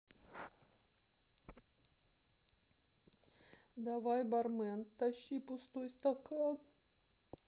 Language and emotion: Russian, sad